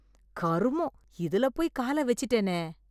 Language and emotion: Tamil, disgusted